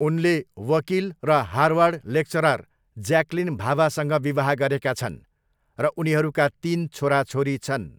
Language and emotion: Nepali, neutral